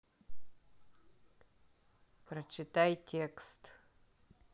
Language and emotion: Russian, neutral